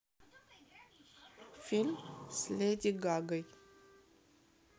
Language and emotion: Russian, neutral